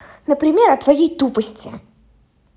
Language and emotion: Russian, angry